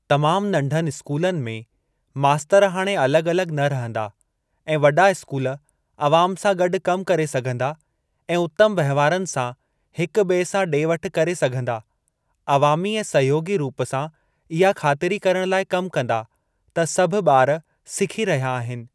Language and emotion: Sindhi, neutral